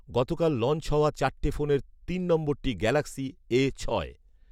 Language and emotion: Bengali, neutral